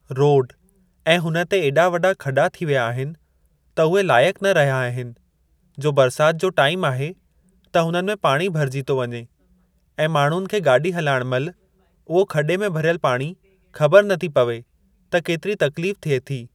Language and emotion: Sindhi, neutral